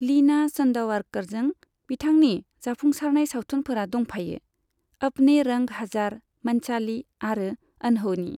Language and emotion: Bodo, neutral